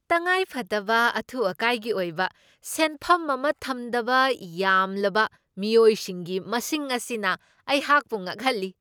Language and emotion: Manipuri, surprised